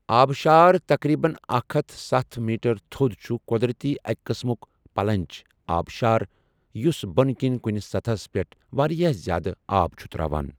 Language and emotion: Kashmiri, neutral